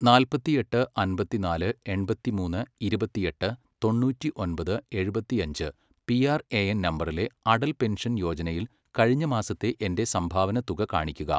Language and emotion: Malayalam, neutral